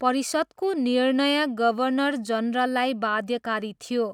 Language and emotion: Nepali, neutral